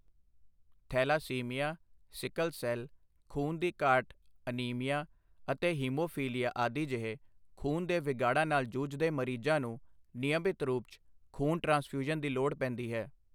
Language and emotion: Punjabi, neutral